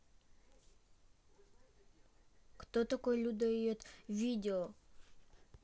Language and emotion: Russian, neutral